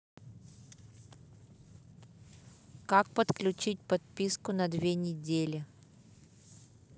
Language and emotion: Russian, neutral